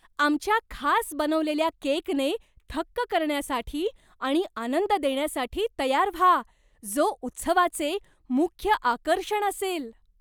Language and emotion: Marathi, surprised